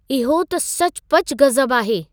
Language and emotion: Sindhi, surprised